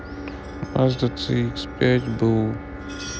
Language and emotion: Russian, sad